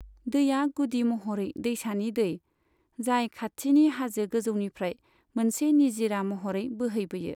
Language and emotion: Bodo, neutral